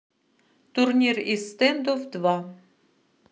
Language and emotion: Russian, neutral